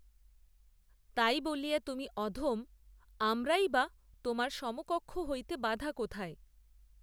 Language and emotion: Bengali, neutral